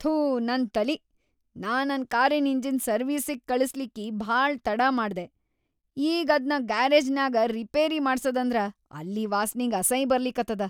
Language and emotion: Kannada, disgusted